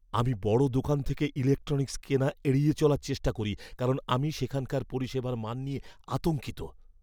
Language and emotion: Bengali, fearful